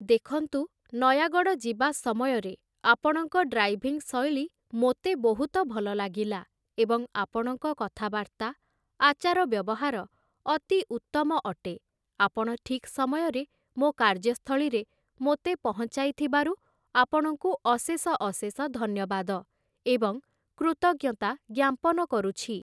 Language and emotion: Odia, neutral